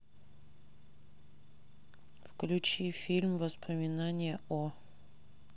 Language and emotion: Russian, neutral